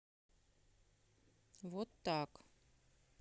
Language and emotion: Russian, neutral